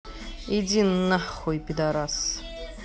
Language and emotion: Russian, angry